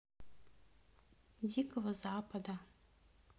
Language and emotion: Russian, neutral